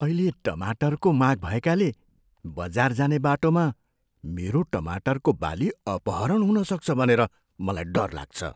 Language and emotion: Nepali, fearful